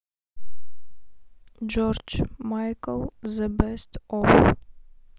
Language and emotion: Russian, neutral